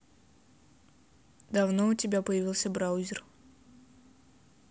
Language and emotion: Russian, neutral